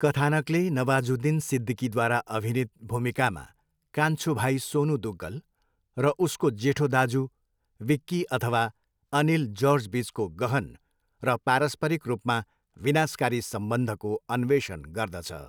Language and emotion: Nepali, neutral